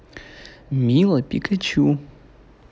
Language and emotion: Russian, positive